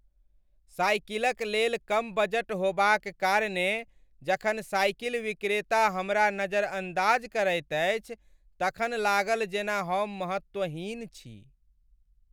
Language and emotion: Maithili, sad